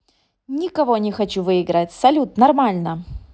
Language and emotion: Russian, positive